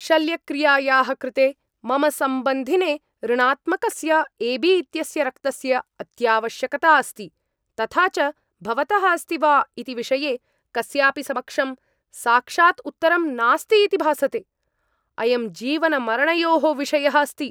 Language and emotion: Sanskrit, angry